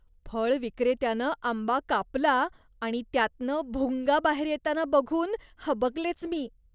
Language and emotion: Marathi, disgusted